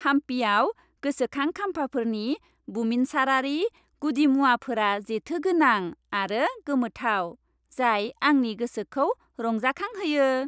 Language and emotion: Bodo, happy